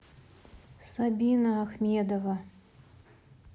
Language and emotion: Russian, sad